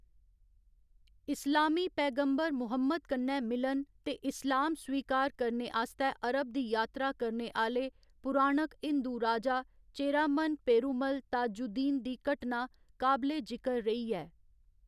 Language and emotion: Dogri, neutral